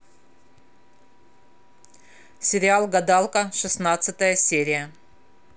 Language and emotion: Russian, neutral